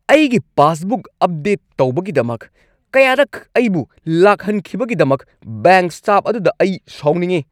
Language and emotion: Manipuri, angry